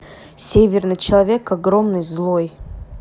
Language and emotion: Russian, neutral